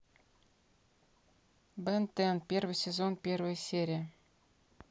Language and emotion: Russian, neutral